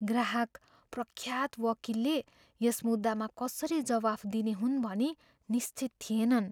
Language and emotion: Nepali, fearful